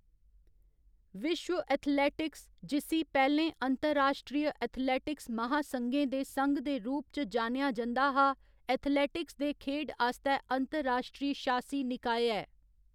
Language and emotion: Dogri, neutral